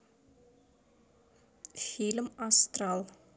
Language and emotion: Russian, neutral